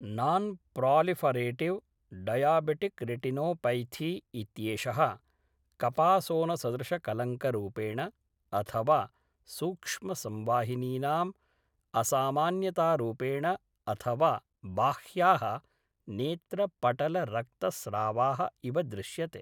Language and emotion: Sanskrit, neutral